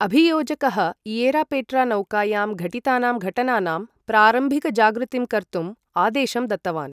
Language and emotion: Sanskrit, neutral